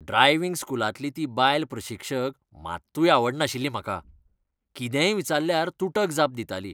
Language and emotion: Goan Konkani, disgusted